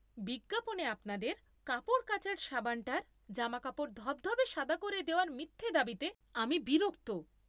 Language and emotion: Bengali, angry